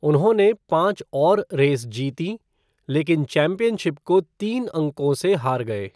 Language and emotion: Hindi, neutral